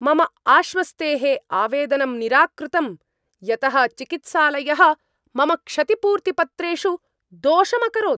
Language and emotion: Sanskrit, angry